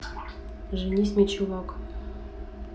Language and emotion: Russian, neutral